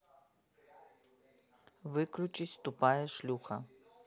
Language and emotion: Russian, angry